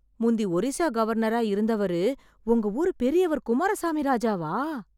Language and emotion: Tamil, surprised